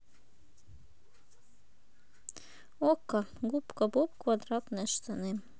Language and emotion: Russian, neutral